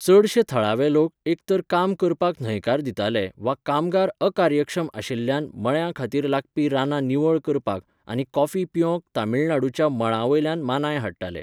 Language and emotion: Goan Konkani, neutral